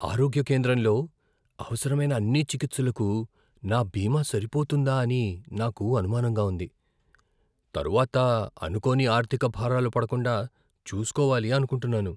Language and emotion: Telugu, fearful